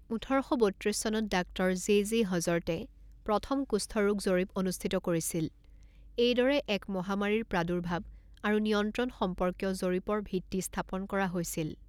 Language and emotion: Assamese, neutral